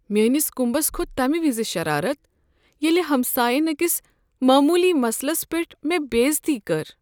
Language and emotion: Kashmiri, sad